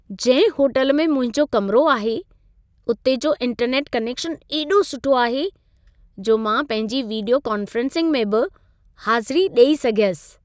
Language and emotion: Sindhi, happy